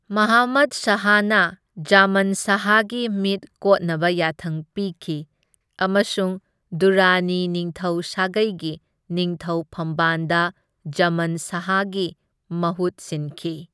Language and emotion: Manipuri, neutral